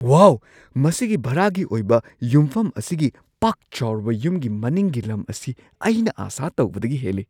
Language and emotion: Manipuri, surprised